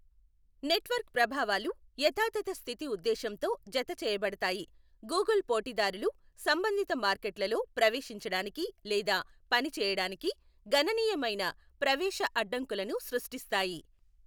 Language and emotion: Telugu, neutral